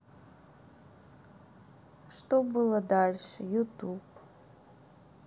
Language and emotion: Russian, neutral